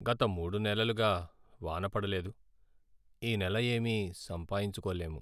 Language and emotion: Telugu, sad